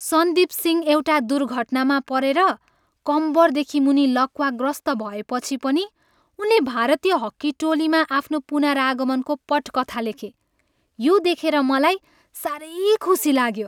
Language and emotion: Nepali, happy